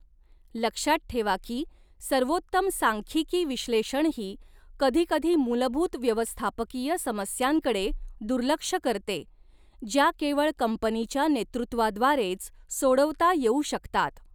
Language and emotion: Marathi, neutral